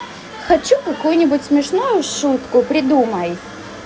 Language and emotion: Russian, positive